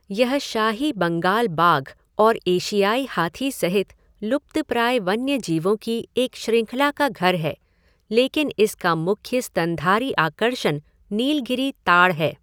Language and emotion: Hindi, neutral